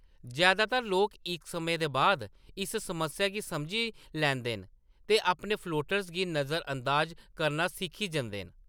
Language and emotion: Dogri, neutral